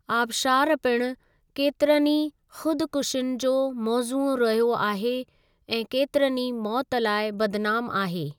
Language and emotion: Sindhi, neutral